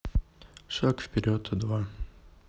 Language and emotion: Russian, neutral